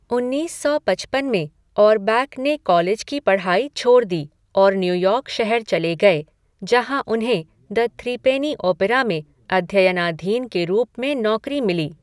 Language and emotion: Hindi, neutral